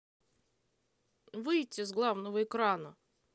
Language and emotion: Russian, neutral